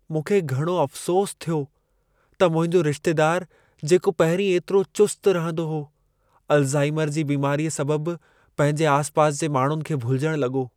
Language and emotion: Sindhi, sad